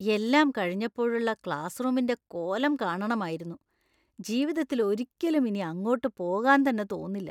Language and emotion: Malayalam, disgusted